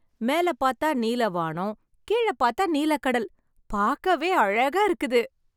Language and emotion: Tamil, happy